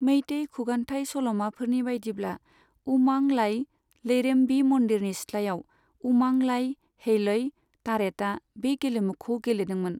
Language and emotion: Bodo, neutral